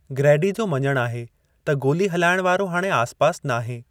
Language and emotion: Sindhi, neutral